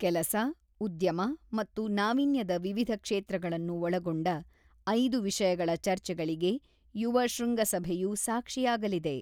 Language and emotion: Kannada, neutral